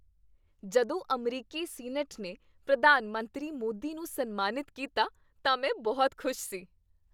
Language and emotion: Punjabi, happy